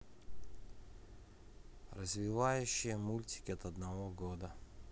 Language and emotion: Russian, neutral